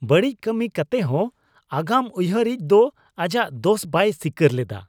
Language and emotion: Santali, disgusted